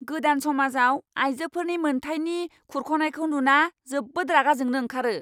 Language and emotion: Bodo, angry